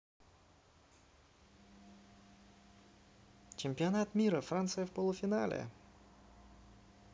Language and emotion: Russian, positive